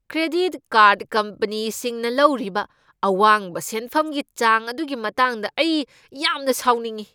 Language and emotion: Manipuri, angry